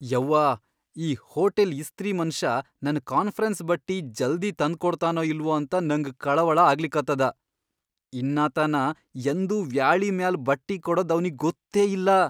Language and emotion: Kannada, fearful